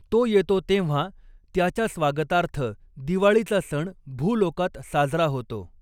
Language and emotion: Marathi, neutral